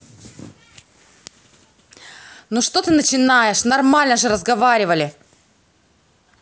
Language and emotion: Russian, angry